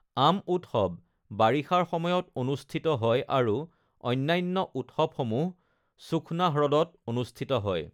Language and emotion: Assamese, neutral